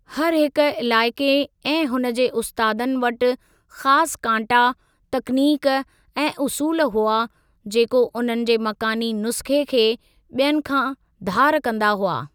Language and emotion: Sindhi, neutral